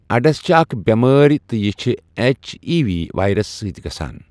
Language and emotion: Kashmiri, neutral